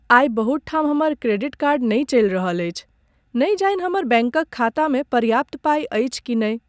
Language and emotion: Maithili, sad